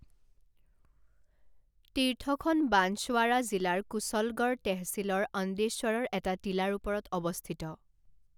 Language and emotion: Assamese, neutral